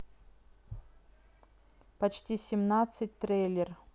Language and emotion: Russian, neutral